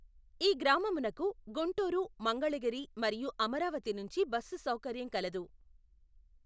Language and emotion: Telugu, neutral